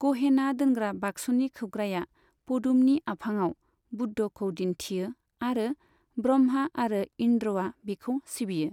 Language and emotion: Bodo, neutral